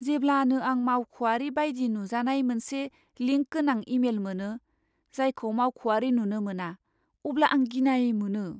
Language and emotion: Bodo, fearful